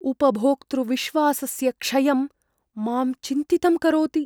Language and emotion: Sanskrit, fearful